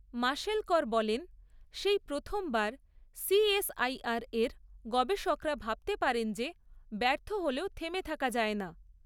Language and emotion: Bengali, neutral